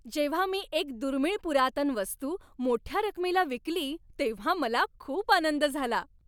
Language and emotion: Marathi, happy